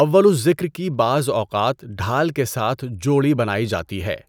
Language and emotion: Urdu, neutral